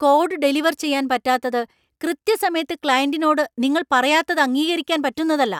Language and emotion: Malayalam, angry